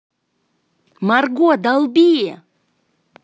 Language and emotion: Russian, positive